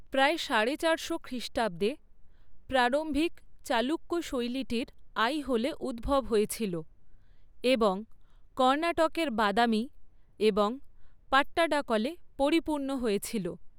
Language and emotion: Bengali, neutral